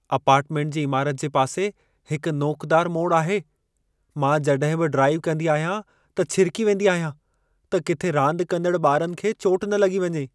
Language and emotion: Sindhi, fearful